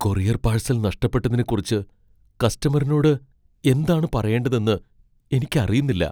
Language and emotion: Malayalam, fearful